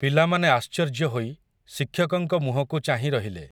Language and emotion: Odia, neutral